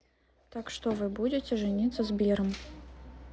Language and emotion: Russian, neutral